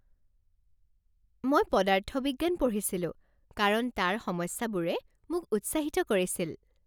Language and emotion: Assamese, happy